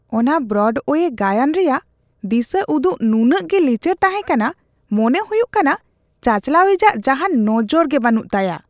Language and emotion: Santali, disgusted